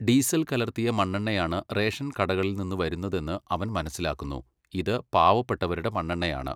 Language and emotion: Malayalam, neutral